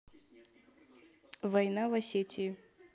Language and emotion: Russian, neutral